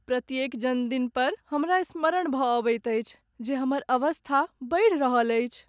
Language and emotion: Maithili, sad